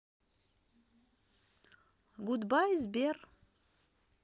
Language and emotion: Russian, neutral